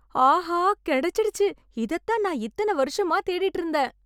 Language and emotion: Tamil, happy